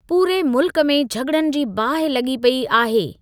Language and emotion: Sindhi, neutral